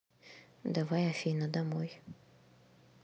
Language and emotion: Russian, neutral